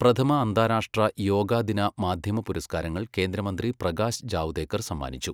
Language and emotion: Malayalam, neutral